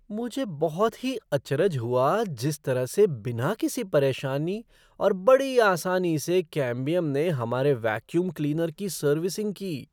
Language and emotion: Hindi, surprised